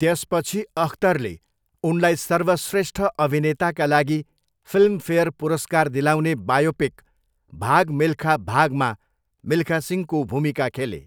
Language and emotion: Nepali, neutral